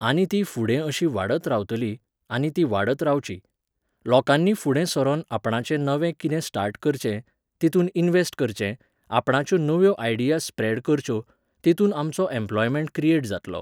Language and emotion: Goan Konkani, neutral